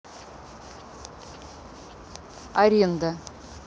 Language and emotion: Russian, neutral